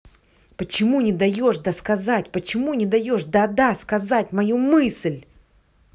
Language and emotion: Russian, angry